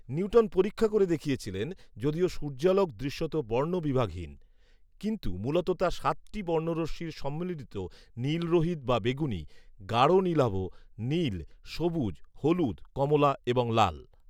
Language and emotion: Bengali, neutral